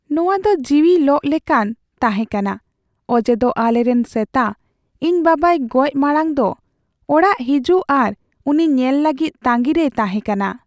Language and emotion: Santali, sad